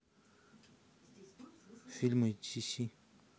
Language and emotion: Russian, neutral